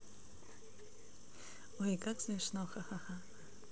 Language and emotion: Russian, neutral